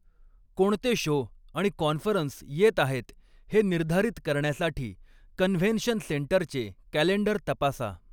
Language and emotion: Marathi, neutral